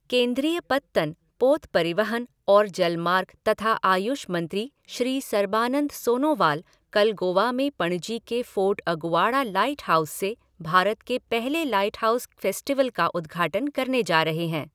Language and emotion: Hindi, neutral